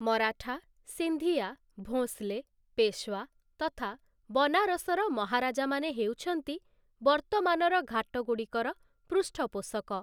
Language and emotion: Odia, neutral